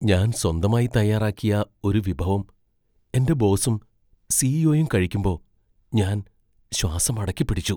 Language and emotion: Malayalam, fearful